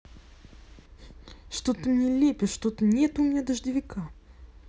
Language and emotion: Russian, angry